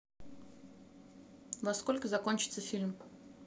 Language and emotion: Russian, neutral